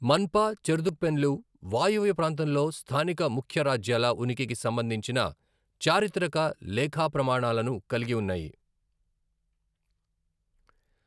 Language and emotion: Telugu, neutral